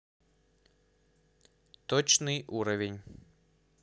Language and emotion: Russian, neutral